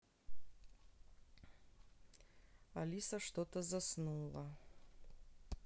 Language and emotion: Russian, neutral